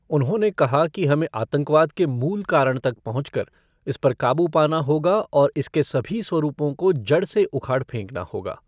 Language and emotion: Hindi, neutral